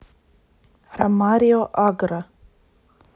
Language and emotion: Russian, neutral